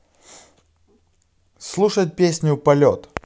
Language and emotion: Russian, positive